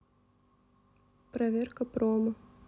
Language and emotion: Russian, neutral